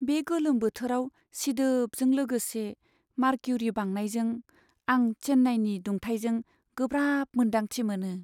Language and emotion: Bodo, sad